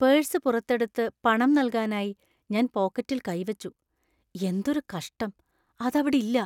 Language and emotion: Malayalam, fearful